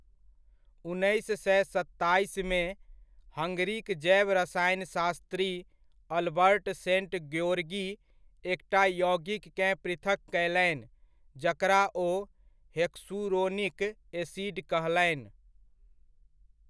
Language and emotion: Maithili, neutral